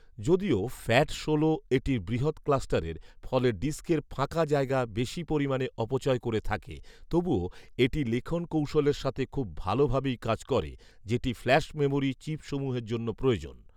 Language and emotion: Bengali, neutral